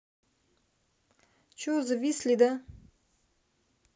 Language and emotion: Russian, neutral